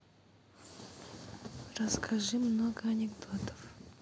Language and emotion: Russian, neutral